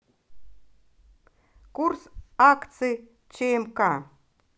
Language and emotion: Russian, positive